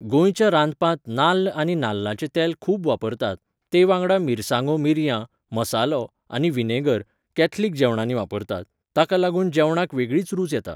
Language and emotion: Goan Konkani, neutral